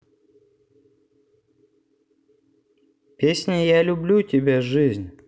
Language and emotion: Russian, neutral